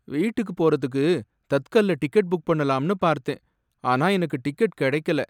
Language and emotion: Tamil, sad